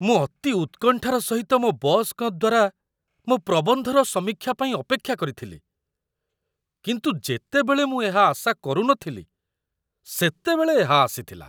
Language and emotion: Odia, surprised